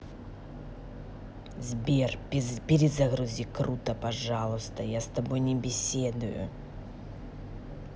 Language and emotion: Russian, angry